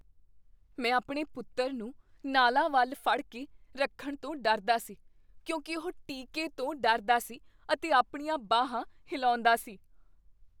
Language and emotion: Punjabi, fearful